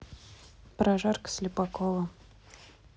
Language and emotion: Russian, neutral